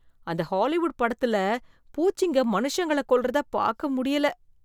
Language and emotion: Tamil, disgusted